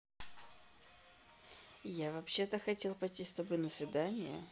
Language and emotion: Russian, neutral